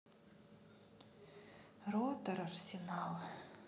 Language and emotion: Russian, sad